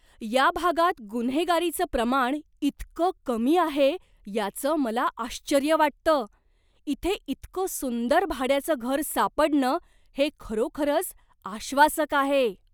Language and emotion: Marathi, surprised